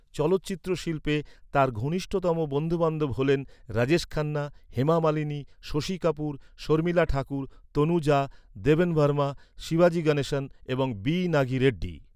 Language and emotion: Bengali, neutral